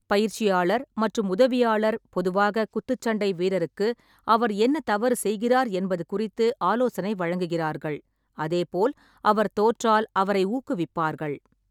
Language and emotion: Tamil, neutral